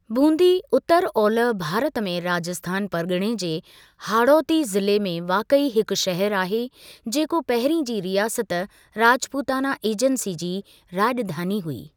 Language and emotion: Sindhi, neutral